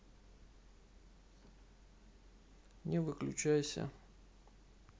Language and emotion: Russian, sad